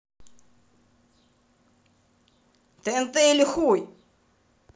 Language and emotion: Russian, angry